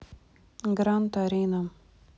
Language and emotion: Russian, neutral